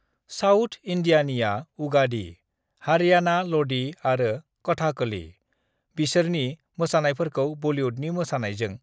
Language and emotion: Bodo, neutral